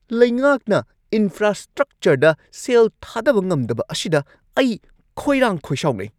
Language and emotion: Manipuri, angry